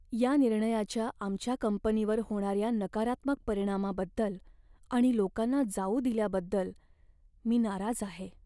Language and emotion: Marathi, sad